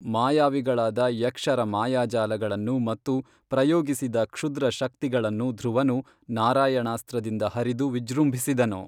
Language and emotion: Kannada, neutral